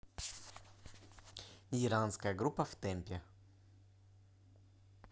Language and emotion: Russian, neutral